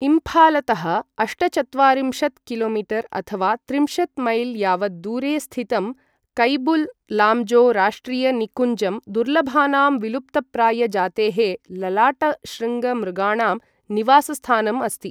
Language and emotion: Sanskrit, neutral